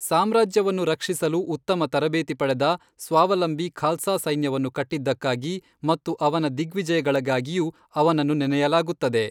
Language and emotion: Kannada, neutral